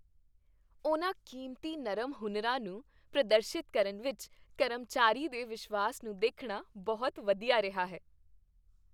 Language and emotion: Punjabi, happy